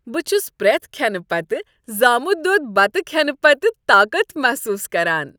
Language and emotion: Kashmiri, happy